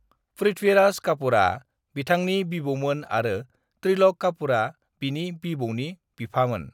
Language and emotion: Bodo, neutral